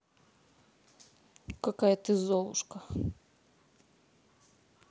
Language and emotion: Russian, neutral